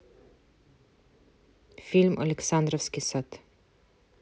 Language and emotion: Russian, neutral